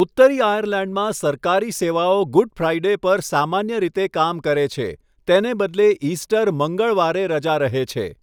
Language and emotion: Gujarati, neutral